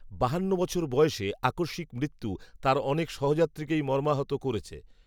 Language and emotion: Bengali, neutral